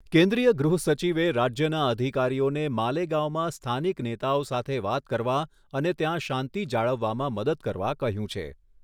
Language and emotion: Gujarati, neutral